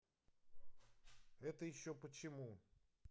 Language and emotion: Russian, neutral